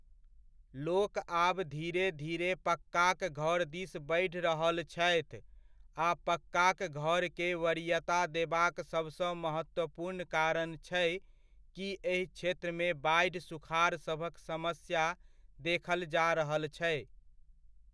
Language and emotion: Maithili, neutral